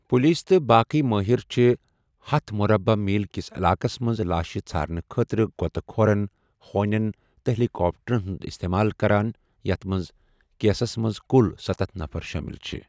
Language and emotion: Kashmiri, neutral